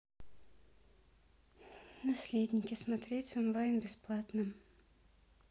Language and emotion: Russian, neutral